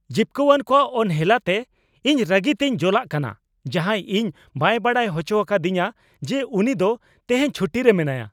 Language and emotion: Santali, angry